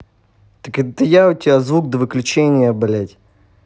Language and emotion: Russian, angry